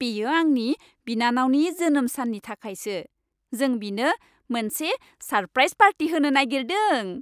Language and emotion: Bodo, happy